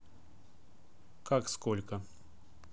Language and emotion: Russian, neutral